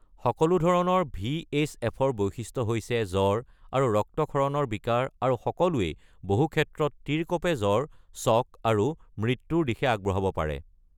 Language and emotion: Assamese, neutral